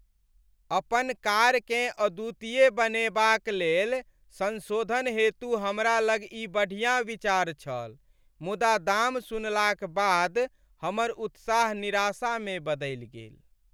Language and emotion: Maithili, sad